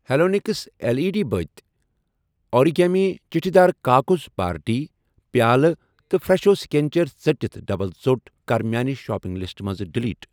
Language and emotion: Kashmiri, neutral